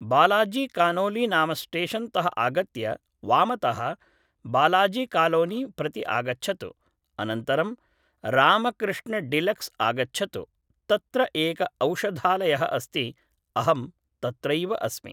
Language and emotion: Sanskrit, neutral